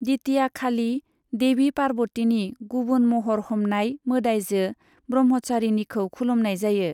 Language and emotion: Bodo, neutral